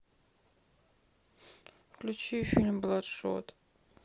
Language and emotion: Russian, sad